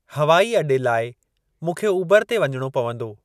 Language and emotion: Sindhi, neutral